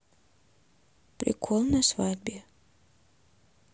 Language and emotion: Russian, neutral